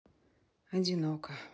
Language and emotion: Russian, sad